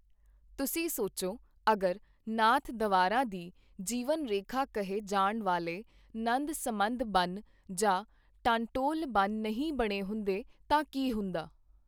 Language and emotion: Punjabi, neutral